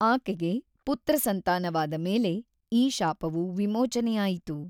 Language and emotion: Kannada, neutral